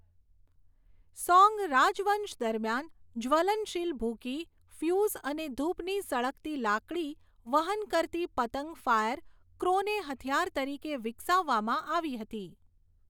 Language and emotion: Gujarati, neutral